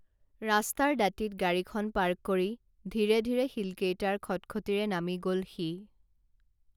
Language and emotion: Assamese, neutral